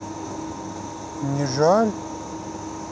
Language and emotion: Russian, neutral